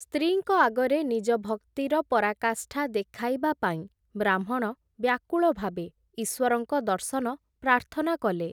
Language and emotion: Odia, neutral